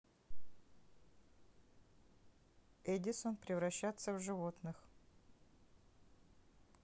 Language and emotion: Russian, neutral